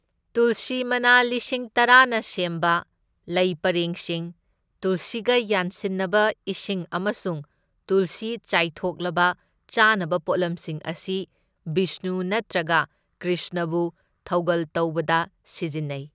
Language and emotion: Manipuri, neutral